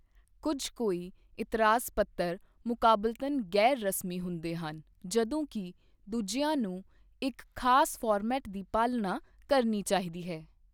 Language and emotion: Punjabi, neutral